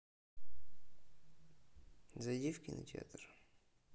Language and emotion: Russian, neutral